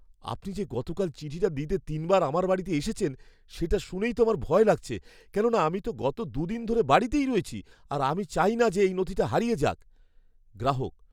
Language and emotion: Bengali, fearful